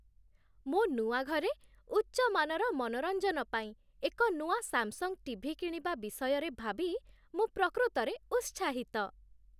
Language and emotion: Odia, happy